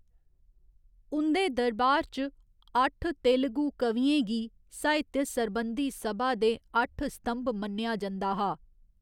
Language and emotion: Dogri, neutral